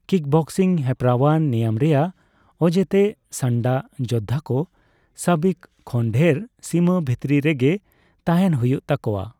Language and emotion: Santali, neutral